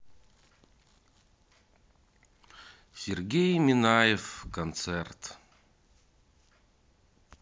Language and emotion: Russian, sad